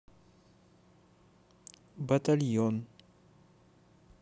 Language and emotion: Russian, neutral